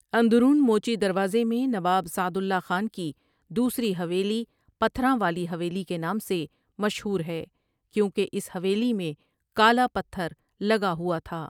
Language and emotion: Urdu, neutral